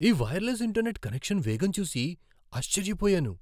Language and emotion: Telugu, surprised